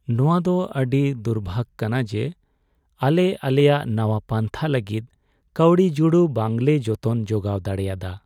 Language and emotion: Santali, sad